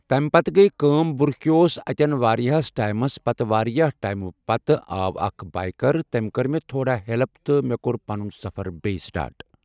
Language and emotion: Kashmiri, neutral